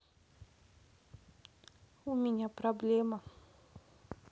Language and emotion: Russian, sad